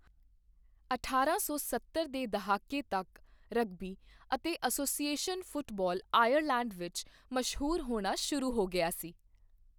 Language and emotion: Punjabi, neutral